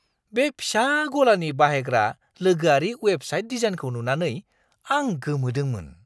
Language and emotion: Bodo, surprised